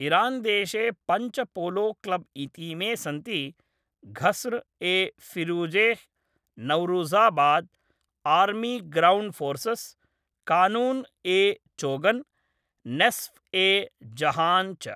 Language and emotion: Sanskrit, neutral